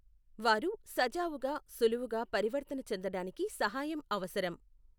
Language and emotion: Telugu, neutral